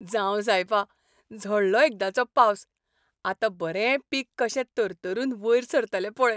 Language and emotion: Goan Konkani, happy